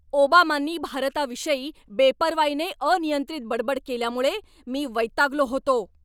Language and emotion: Marathi, angry